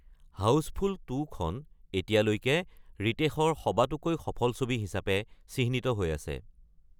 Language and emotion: Assamese, neutral